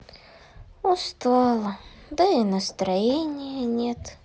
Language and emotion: Russian, sad